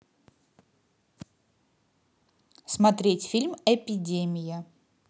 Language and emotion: Russian, positive